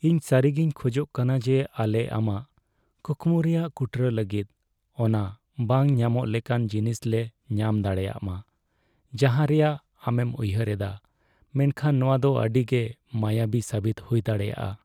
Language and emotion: Santali, sad